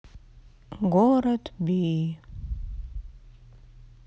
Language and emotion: Russian, sad